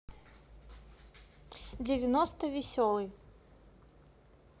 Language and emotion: Russian, neutral